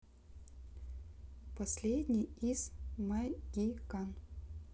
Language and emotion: Russian, neutral